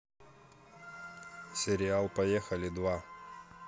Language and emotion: Russian, neutral